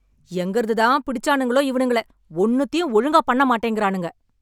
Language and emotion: Tamil, angry